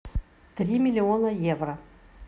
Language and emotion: Russian, neutral